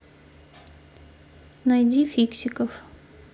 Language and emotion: Russian, neutral